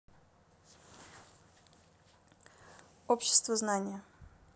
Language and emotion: Russian, neutral